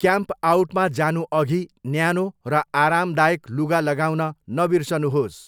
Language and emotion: Nepali, neutral